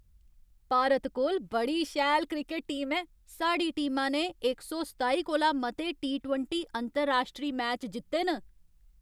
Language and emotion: Dogri, happy